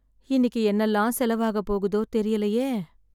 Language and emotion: Tamil, sad